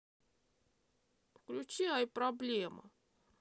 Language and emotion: Russian, sad